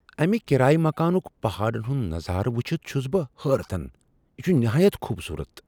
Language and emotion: Kashmiri, surprised